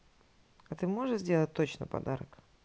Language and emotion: Russian, neutral